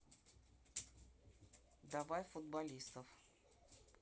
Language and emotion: Russian, neutral